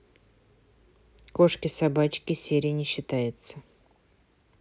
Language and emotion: Russian, neutral